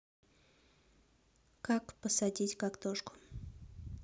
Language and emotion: Russian, neutral